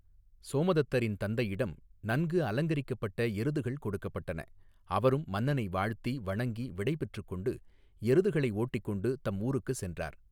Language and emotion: Tamil, neutral